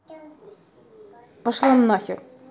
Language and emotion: Russian, angry